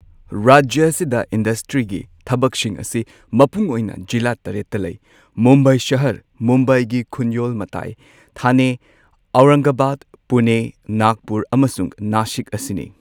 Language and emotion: Manipuri, neutral